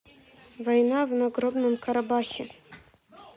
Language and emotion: Russian, neutral